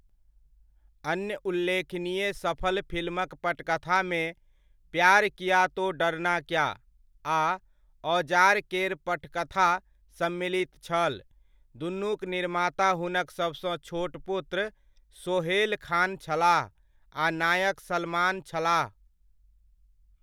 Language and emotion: Maithili, neutral